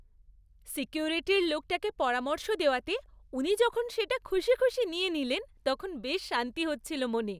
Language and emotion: Bengali, happy